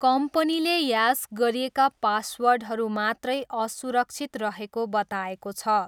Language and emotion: Nepali, neutral